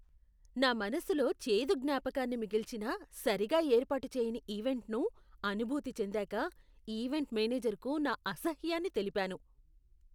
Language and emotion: Telugu, disgusted